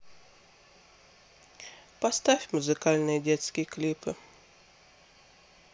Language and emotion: Russian, neutral